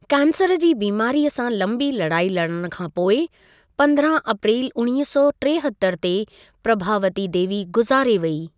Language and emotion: Sindhi, neutral